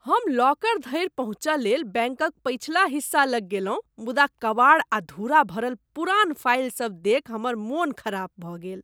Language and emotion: Maithili, disgusted